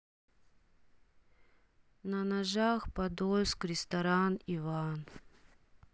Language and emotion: Russian, sad